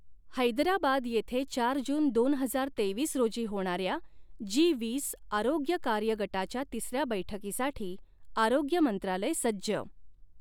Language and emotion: Marathi, neutral